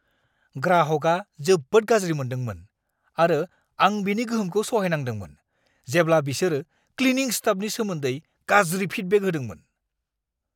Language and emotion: Bodo, angry